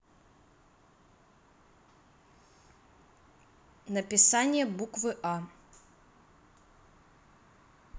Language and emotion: Russian, neutral